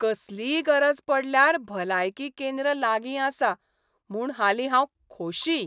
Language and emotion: Goan Konkani, happy